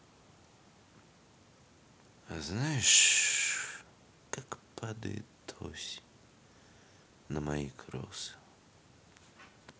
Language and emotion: Russian, sad